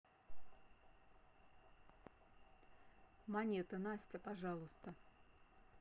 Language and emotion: Russian, neutral